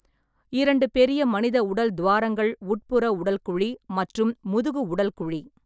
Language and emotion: Tamil, neutral